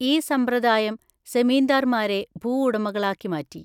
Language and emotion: Malayalam, neutral